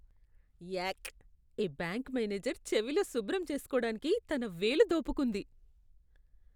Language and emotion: Telugu, disgusted